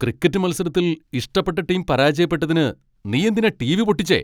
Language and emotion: Malayalam, angry